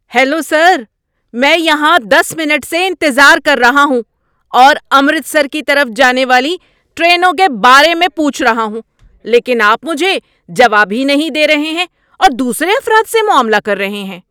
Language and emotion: Urdu, angry